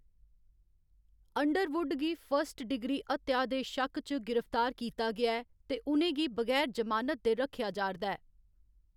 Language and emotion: Dogri, neutral